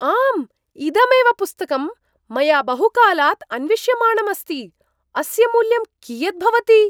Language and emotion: Sanskrit, surprised